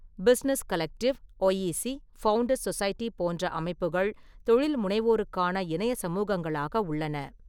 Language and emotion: Tamil, neutral